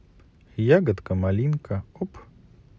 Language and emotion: Russian, neutral